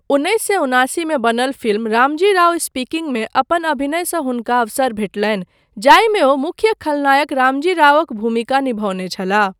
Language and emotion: Maithili, neutral